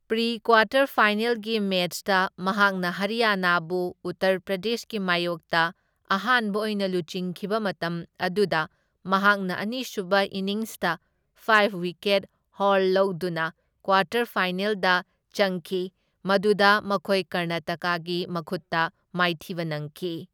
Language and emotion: Manipuri, neutral